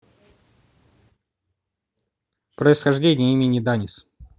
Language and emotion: Russian, neutral